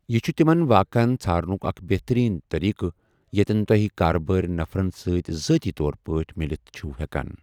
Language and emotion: Kashmiri, neutral